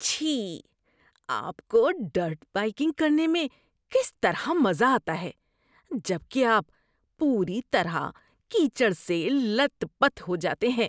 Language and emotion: Urdu, disgusted